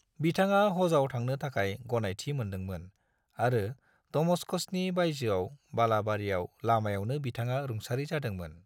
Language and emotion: Bodo, neutral